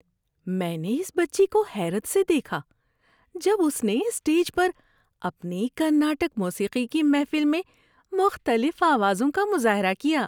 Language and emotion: Urdu, happy